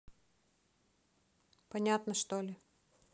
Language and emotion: Russian, neutral